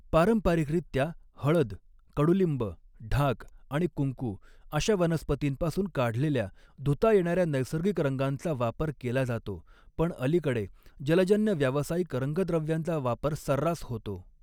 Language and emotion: Marathi, neutral